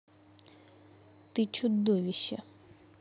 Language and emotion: Russian, angry